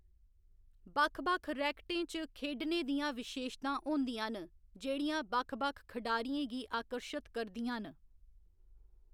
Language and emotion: Dogri, neutral